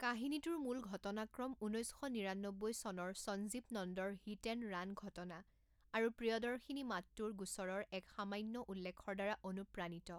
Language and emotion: Assamese, neutral